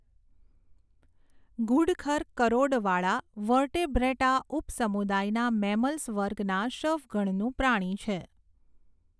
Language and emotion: Gujarati, neutral